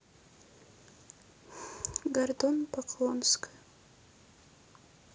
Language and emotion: Russian, sad